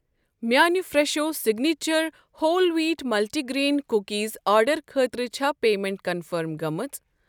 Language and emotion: Kashmiri, neutral